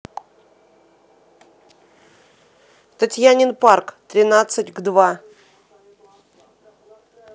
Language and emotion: Russian, neutral